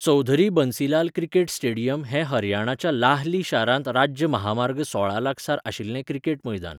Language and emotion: Goan Konkani, neutral